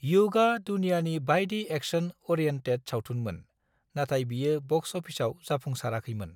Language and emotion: Bodo, neutral